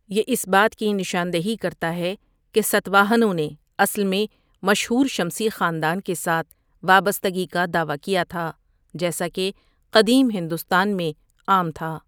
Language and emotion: Urdu, neutral